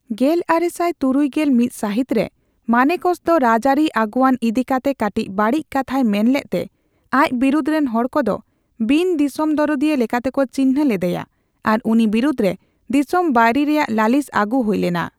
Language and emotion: Santali, neutral